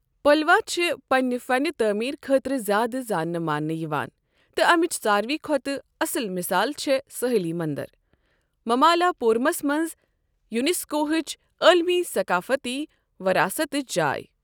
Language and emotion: Kashmiri, neutral